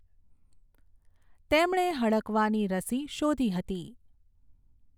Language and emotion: Gujarati, neutral